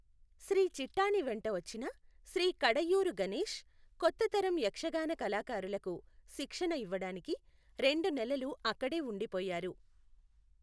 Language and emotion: Telugu, neutral